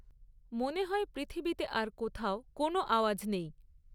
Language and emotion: Bengali, neutral